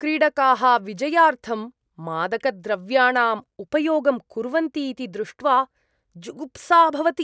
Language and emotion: Sanskrit, disgusted